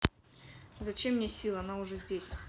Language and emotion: Russian, neutral